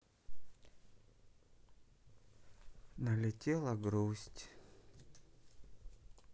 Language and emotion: Russian, sad